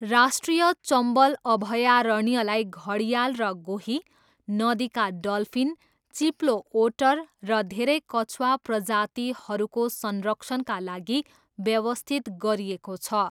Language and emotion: Nepali, neutral